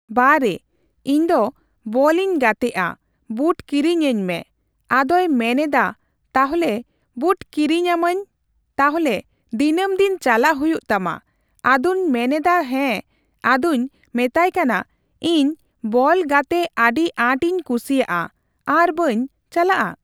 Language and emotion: Santali, neutral